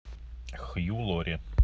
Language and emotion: Russian, neutral